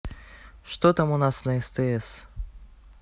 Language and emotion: Russian, neutral